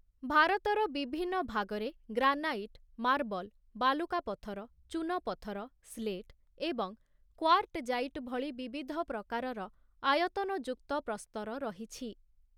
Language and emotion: Odia, neutral